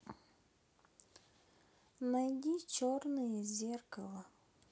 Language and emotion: Russian, sad